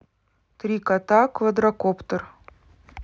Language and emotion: Russian, neutral